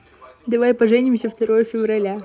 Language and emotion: Russian, positive